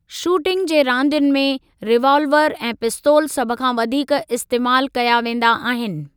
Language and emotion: Sindhi, neutral